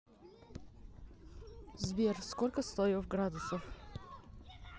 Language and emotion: Russian, neutral